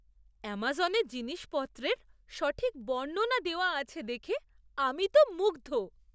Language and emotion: Bengali, surprised